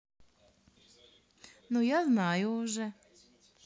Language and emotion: Russian, positive